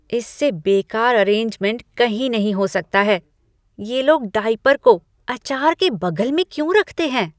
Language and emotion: Hindi, disgusted